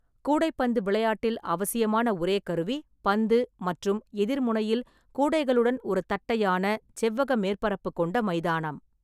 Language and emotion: Tamil, neutral